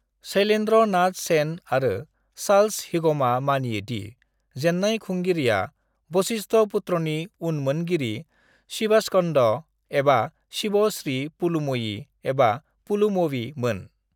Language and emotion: Bodo, neutral